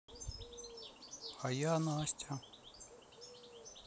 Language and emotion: Russian, sad